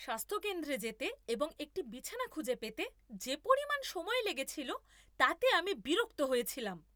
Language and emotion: Bengali, angry